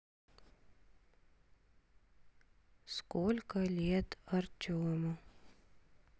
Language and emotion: Russian, sad